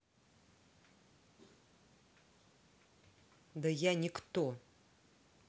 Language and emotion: Russian, angry